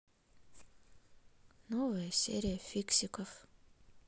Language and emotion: Russian, sad